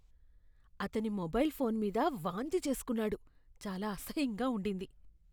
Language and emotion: Telugu, disgusted